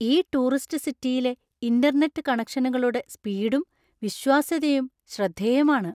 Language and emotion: Malayalam, surprised